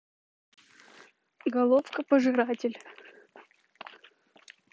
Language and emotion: Russian, neutral